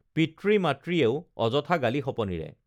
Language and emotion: Assamese, neutral